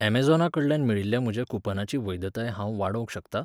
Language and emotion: Goan Konkani, neutral